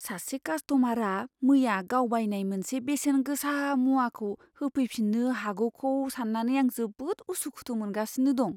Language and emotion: Bodo, fearful